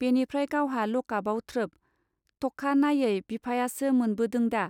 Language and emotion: Bodo, neutral